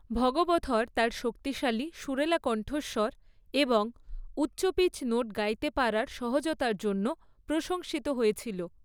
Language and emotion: Bengali, neutral